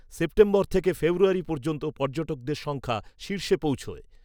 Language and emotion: Bengali, neutral